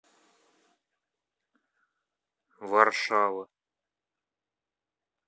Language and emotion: Russian, neutral